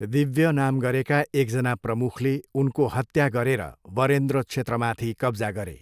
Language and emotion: Nepali, neutral